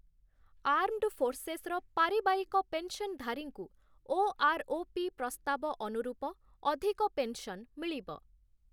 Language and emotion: Odia, neutral